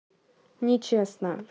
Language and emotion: Russian, neutral